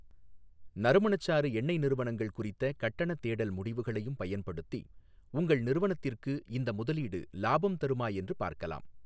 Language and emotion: Tamil, neutral